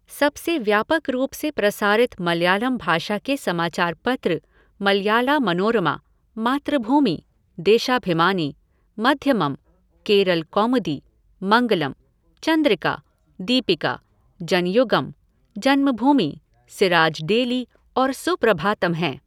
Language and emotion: Hindi, neutral